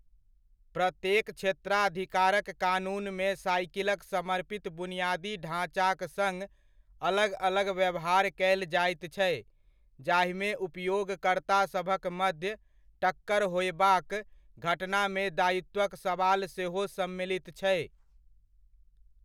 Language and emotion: Maithili, neutral